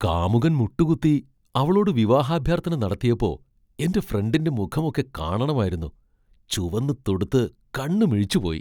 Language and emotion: Malayalam, surprised